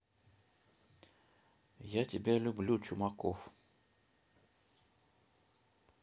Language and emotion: Russian, neutral